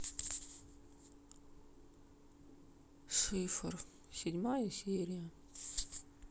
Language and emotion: Russian, sad